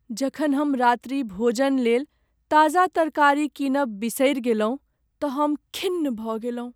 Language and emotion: Maithili, sad